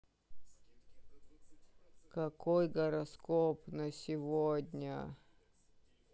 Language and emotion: Russian, sad